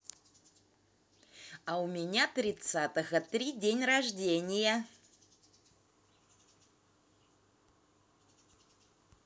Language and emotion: Russian, positive